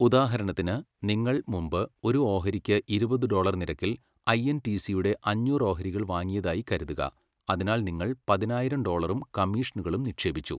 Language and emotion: Malayalam, neutral